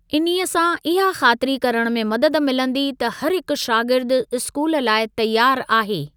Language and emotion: Sindhi, neutral